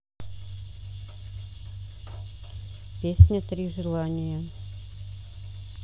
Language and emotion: Russian, neutral